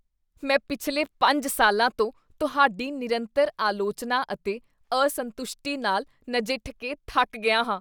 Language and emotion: Punjabi, disgusted